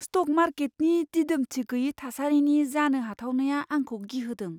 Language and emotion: Bodo, fearful